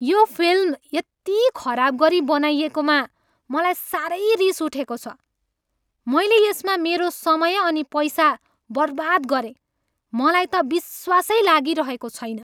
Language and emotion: Nepali, angry